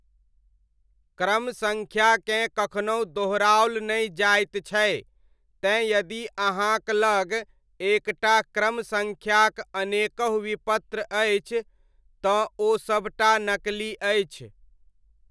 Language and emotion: Maithili, neutral